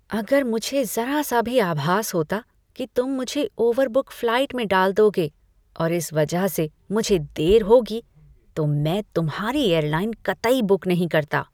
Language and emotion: Hindi, disgusted